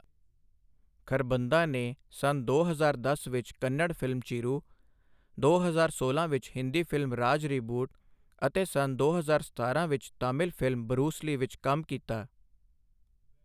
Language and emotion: Punjabi, neutral